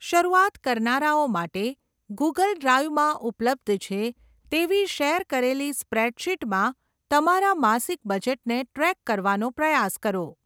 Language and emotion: Gujarati, neutral